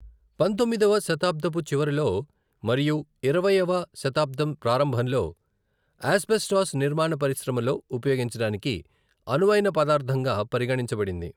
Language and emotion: Telugu, neutral